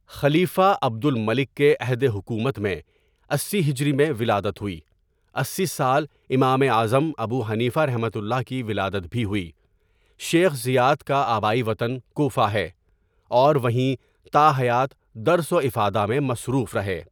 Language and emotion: Urdu, neutral